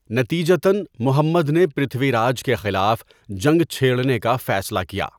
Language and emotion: Urdu, neutral